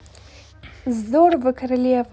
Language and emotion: Russian, positive